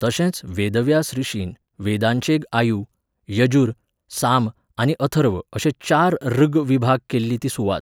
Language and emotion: Goan Konkani, neutral